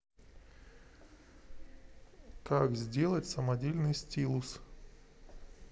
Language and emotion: Russian, neutral